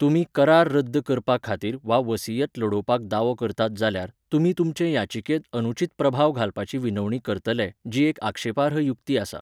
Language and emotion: Goan Konkani, neutral